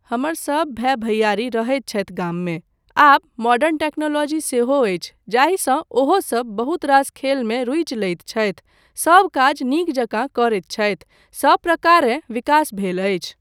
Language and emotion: Maithili, neutral